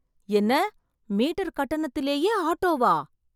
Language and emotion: Tamil, surprised